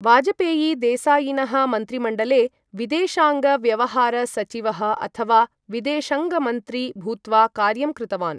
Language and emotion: Sanskrit, neutral